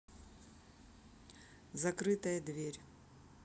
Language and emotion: Russian, neutral